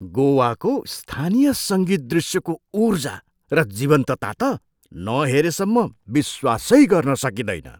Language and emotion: Nepali, surprised